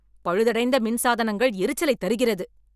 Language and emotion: Tamil, angry